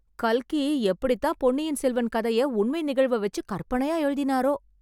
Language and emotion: Tamil, surprised